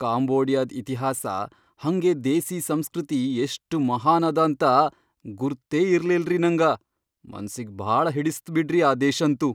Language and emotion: Kannada, surprised